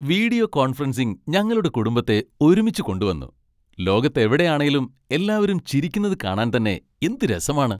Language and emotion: Malayalam, happy